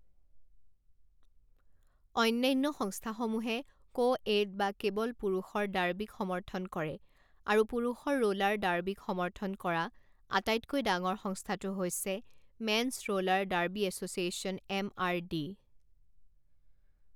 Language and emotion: Assamese, neutral